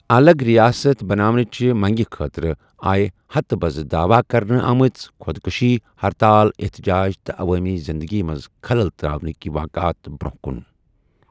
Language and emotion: Kashmiri, neutral